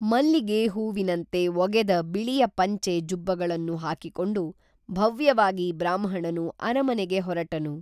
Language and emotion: Kannada, neutral